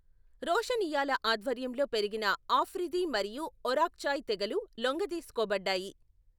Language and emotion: Telugu, neutral